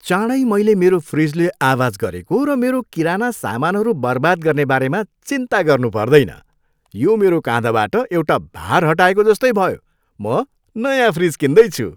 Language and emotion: Nepali, happy